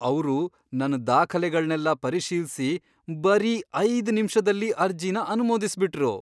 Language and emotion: Kannada, surprised